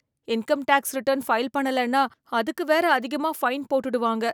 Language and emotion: Tamil, fearful